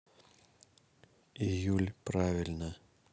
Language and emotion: Russian, neutral